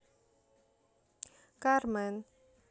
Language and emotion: Russian, neutral